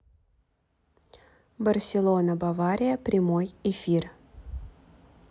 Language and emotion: Russian, neutral